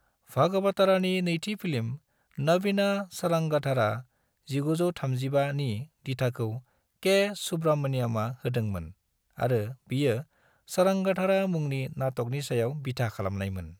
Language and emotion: Bodo, neutral